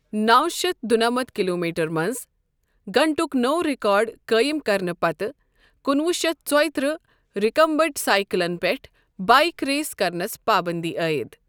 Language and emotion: Kashmiri, neutral